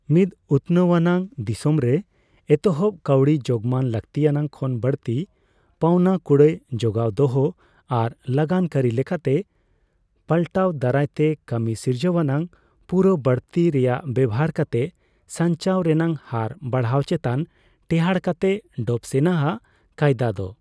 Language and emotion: Santali, neutral